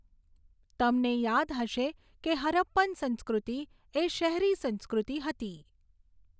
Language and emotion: Gujarati, neutral